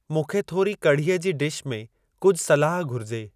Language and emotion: Sindhi, neutral